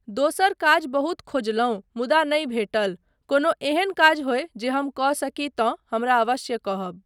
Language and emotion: Maithili, neutral